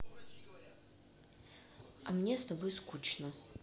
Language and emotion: Russian, neutral